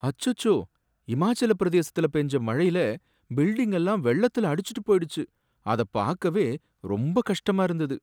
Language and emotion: Tamil, sad